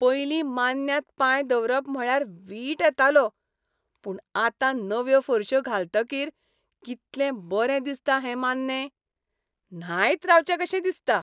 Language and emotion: Goan Konkani, happy